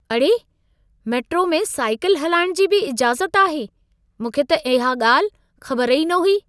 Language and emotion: Sindhi, surprised